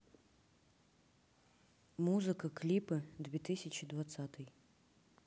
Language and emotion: Russian, neutral